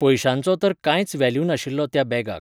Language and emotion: Goan Konkani, neutral